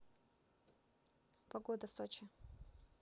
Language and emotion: Russian, neutral